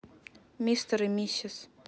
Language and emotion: Russian, neutral